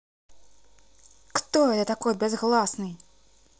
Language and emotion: Russian, angry